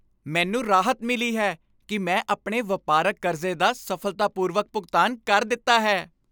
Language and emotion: Punjabi, happy